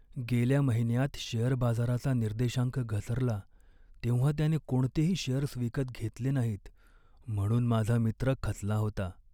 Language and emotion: Marathi, sad